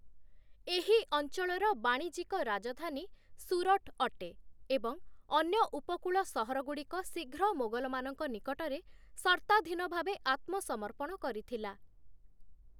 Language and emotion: Odia, neutral